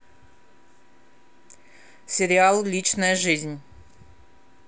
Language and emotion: Russian, neutral